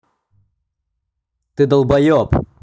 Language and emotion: Russian, angry